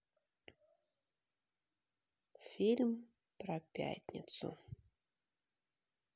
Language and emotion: Russian, sad